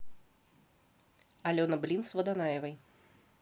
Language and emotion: Russian, neutral